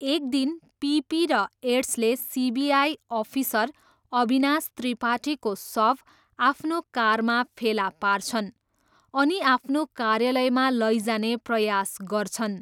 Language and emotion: Nepali, neutral